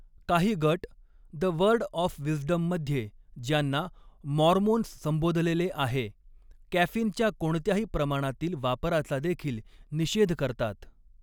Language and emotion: Marathi, neutral